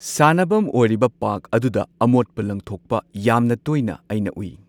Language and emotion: Manipuri, neutral